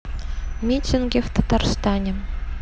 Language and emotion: Russian, neutral